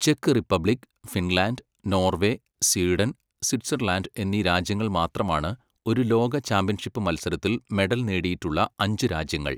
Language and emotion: Malayalam, neutral